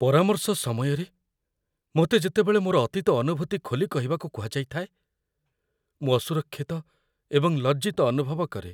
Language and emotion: Odia, fearful